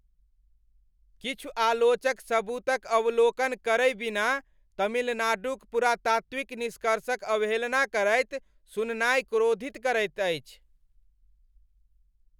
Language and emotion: Maithili, angry